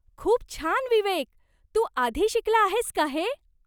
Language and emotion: Marathi, surprised